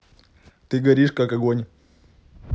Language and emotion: Russian, neutral